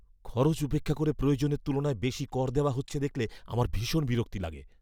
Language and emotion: Bengali, angry